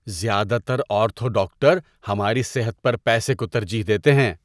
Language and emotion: Urdu, disgusted